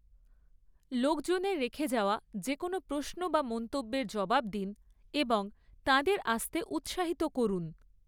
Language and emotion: Bengali, neutral